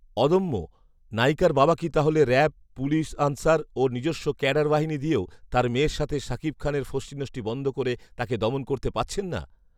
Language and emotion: Bengali, neutral